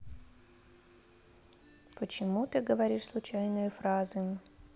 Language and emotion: Russian, neutral